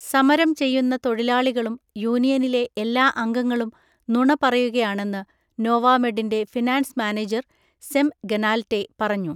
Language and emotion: Malayalam, neutral